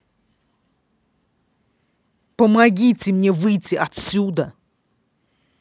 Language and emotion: Russian, angry